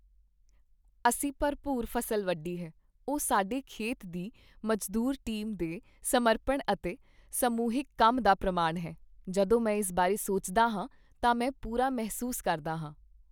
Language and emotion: Punjabi, happy